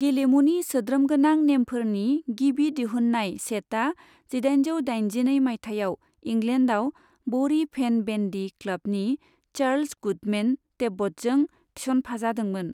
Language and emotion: Bodo, neutral